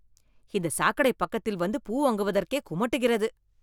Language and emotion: Tamil, disgusted